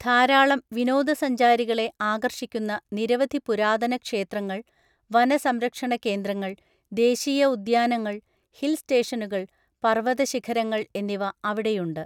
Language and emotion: Malayalam, neutral